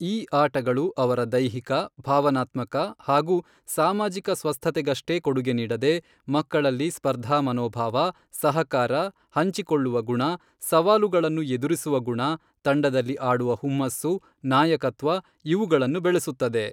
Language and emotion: Kannada, neutral